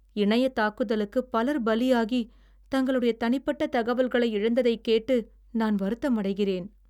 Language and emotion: Tamil, sad